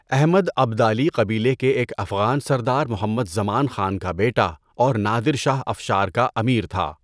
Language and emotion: Urdu, neutral